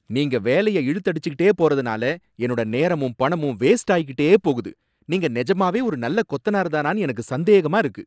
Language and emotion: Tamil, angry